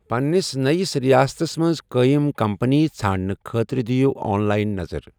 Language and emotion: Kashmiri, neutral